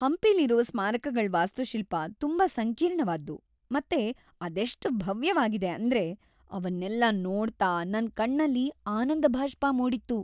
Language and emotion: Kannada, happy